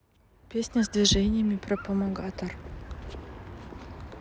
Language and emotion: Russian, neutral